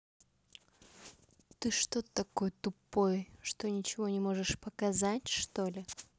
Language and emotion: Russian, neutral